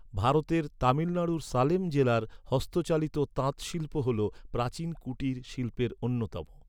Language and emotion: Bengali, neutral